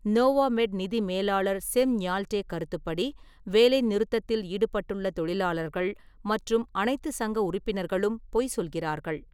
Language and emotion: Tamil, neutral